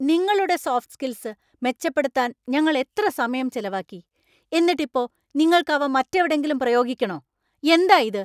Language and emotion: Malayalam, angry